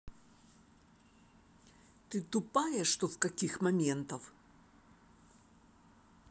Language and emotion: Russian, angry